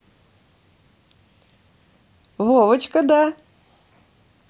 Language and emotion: Russian, positive